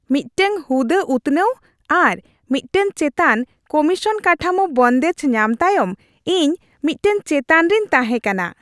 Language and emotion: Santali, happy